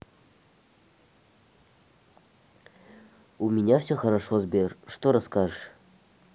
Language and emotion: Russian, neutral